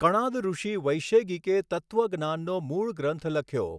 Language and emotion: Gujarati, neutral